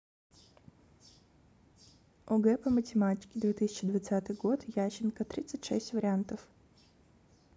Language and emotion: Russian, neutral